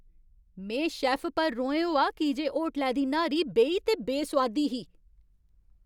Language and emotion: Dogri, angry